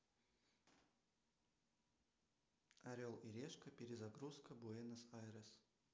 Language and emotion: Russian, neutral